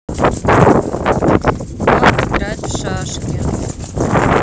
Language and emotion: Russian, neutral